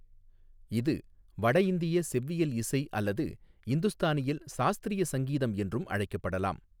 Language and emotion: Tamil, neutral